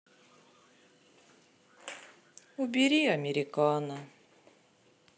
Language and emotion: Russian, sad